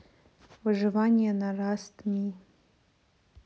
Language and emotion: Russian, neutral